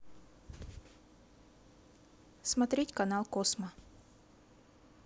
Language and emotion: Russian, neutral